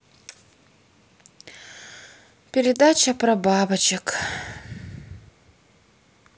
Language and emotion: Russian, sad